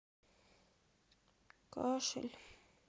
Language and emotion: Russian, sad